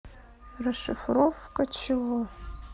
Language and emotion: Russian, neutral